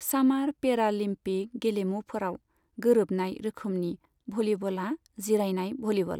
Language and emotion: Bodo, neutral